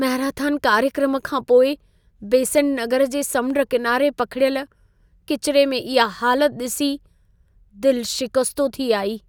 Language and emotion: Sindhi, sad